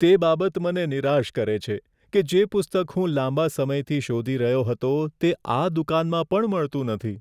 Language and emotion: Gujarati, sad